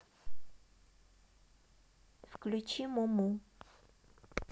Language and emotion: Russian, neutral